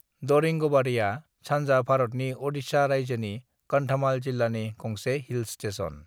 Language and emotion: Bodo, neutral